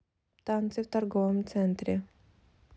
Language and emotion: Russian, neutral